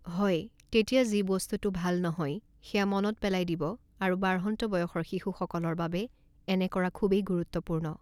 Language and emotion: Assamese, neutral